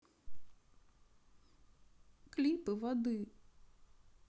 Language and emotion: Russian, sad